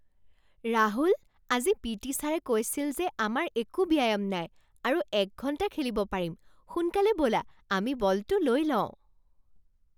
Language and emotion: Assamese, surprised